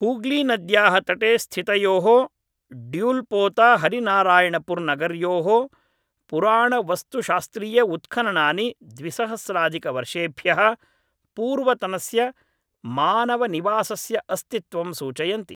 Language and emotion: Sanskrit, neutral